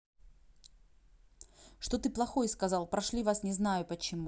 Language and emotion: Russian, angry